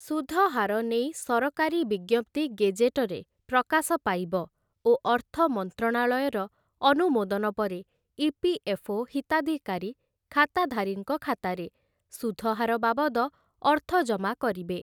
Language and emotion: Odia, neutral